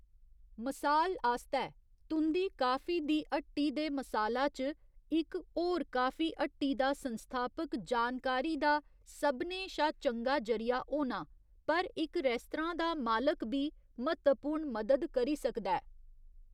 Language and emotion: Dogri, neutral